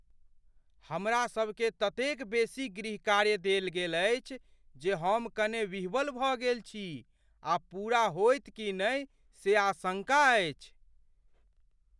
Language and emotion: Maithili, fearful